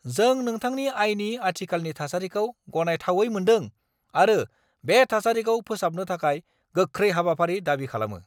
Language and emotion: Bodo, angry